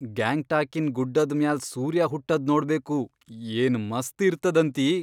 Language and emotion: Kannada, surprised